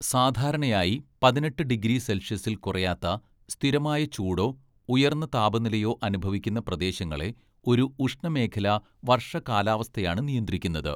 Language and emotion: Malayalam, neutral